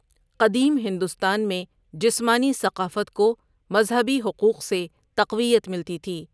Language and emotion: Urdu, neutral